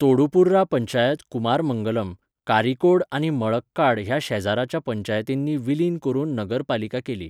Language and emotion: Goan Konkani, neutral